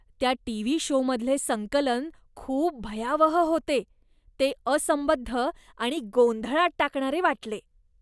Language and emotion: Marathi, disgusted